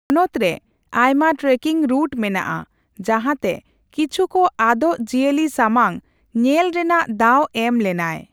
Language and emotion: Santali, neutral